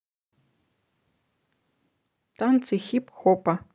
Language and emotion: Russian, neutral